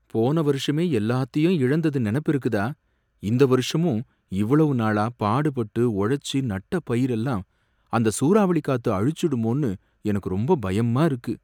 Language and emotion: Tamil, fearful